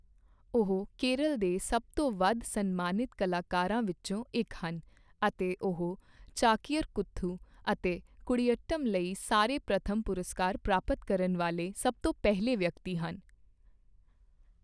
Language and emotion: Punjabi, neutral